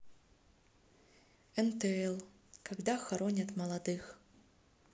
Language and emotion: Russian, sad